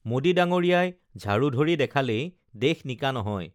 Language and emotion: Assamese, neutral